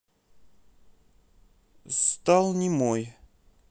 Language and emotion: Russian, neutral